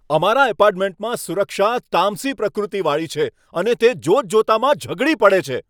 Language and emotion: Gujarati, angry